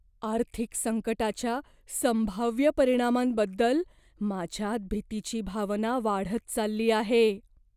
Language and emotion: Marathi, fearful